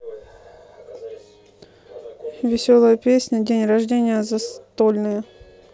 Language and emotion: Russian, neutral